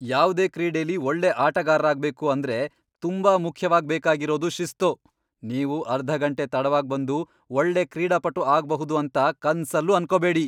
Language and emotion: Kannada, angry